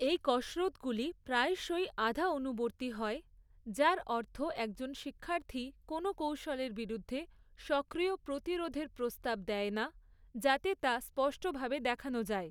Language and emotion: Bengali, neutral